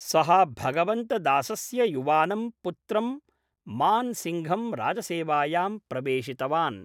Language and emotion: Sanskrit, neutral